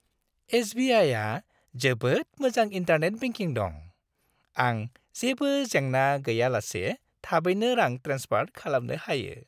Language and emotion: Bodo, happy